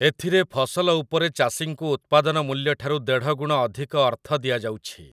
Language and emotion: Odia, neutral